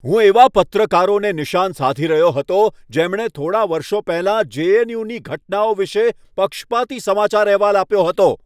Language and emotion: Gujarati, angry